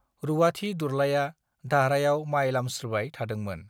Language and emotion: Bodo, neutral